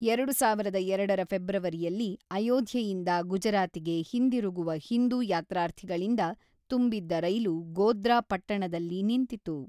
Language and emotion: Kannada, neutral